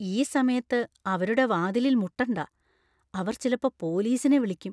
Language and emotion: Malayalam, fearful